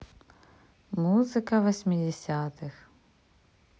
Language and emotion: Russian, neutral